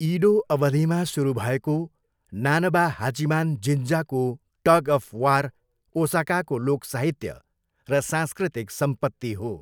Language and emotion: Nepali, neutral